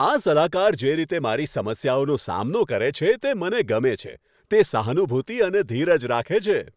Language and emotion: Gujarati, happy